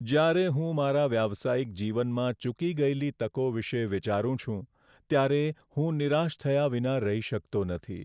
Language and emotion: Gujarati, sad